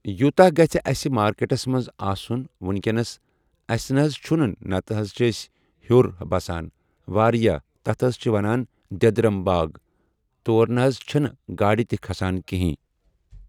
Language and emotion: Kashmiri, neutral